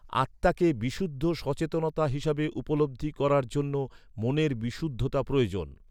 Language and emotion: Bengali, neutral